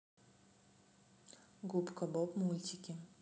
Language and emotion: Russian, neutral